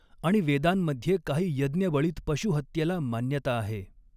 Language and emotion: Marathi, neutral